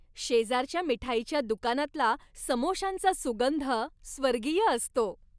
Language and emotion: Marathi, happy